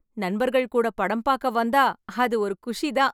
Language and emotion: Tamil, happy